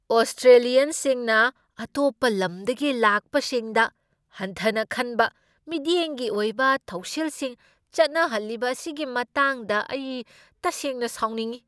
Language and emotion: Manipuri, angry